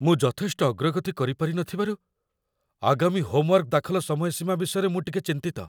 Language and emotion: Odia, fearful